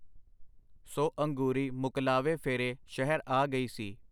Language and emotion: Punjabi, neutral